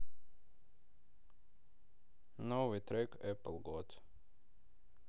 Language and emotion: Russian, neutral